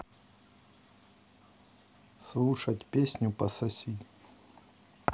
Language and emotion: Russian, neutral